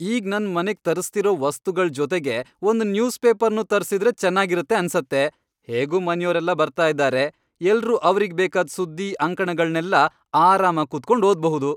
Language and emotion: Kannada, happy